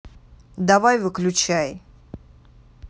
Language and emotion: Russian, angry